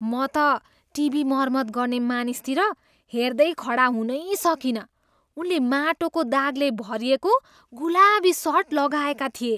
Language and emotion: Nepali, disgusted